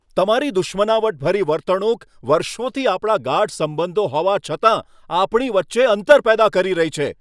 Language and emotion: Gujarati, angry